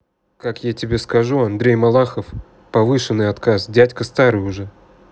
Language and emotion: Russian, neutral